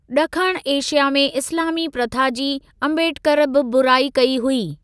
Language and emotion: Sindhi, neutral